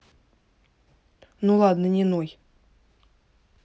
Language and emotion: Russian, neutral